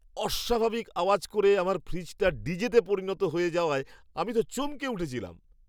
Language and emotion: Bengali, surprised